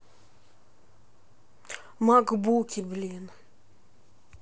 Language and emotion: Russian, neutral